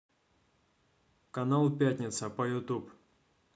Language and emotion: Russian, neutral